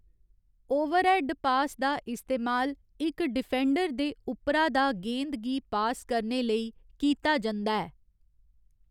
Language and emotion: Dogri, neutral